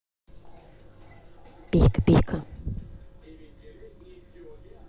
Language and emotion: Russian, neutral